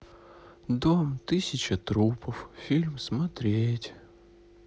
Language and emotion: Russian, sad